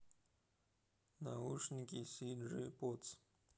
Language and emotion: Russian, neutral